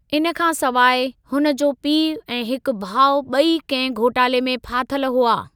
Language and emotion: Sindhi, neutral